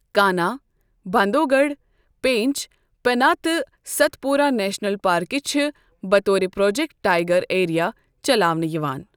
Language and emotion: Kashmiri, neutral